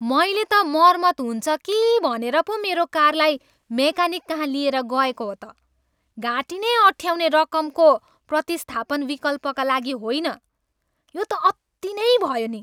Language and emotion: Nepali, angry